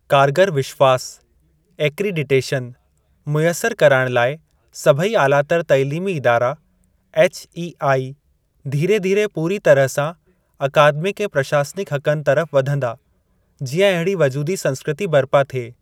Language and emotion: Sindhi, neutral